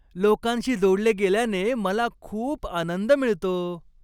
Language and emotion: Marathi, happy